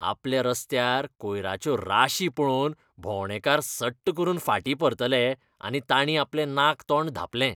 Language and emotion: Goan Konkani, disgusted